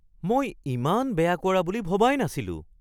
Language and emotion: Assamese, surprised